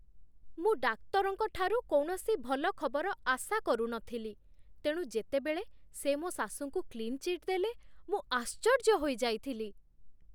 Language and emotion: Odia, surprised